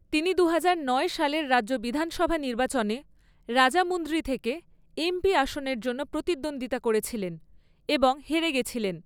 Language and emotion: Bengali, neutral